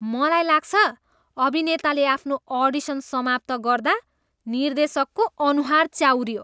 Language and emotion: Nepali, disgusted